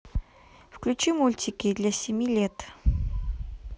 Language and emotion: Russian, neutral